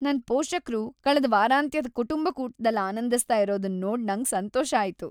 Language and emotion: Kannada, happy